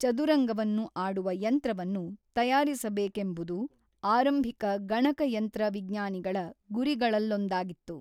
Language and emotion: Kannada, neutral